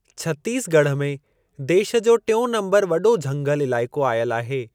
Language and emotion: Sindhi, neutral